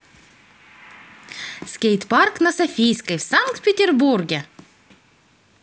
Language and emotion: Russian, positive